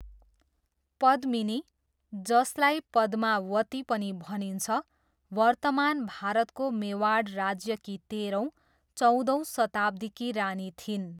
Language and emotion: Nepali, neutral